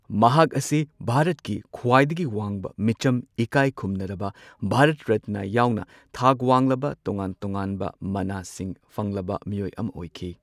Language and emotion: Manipuri, neutral